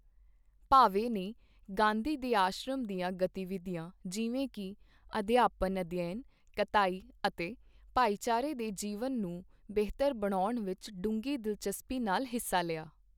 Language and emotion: Punjabi, neutral